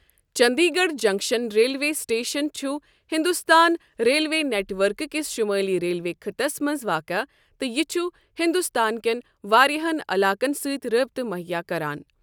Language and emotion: Kashmiri, neutral